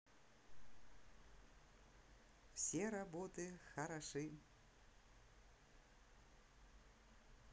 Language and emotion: Russian, positive